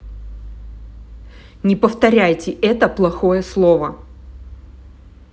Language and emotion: Russian, angry